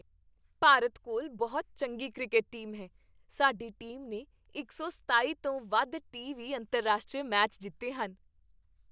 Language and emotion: Punjabi, happy